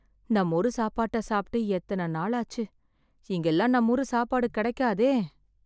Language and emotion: Tamil, sad